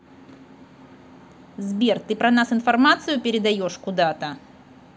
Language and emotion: Russian, angry